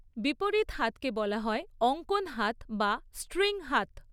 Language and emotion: Bengali, neutral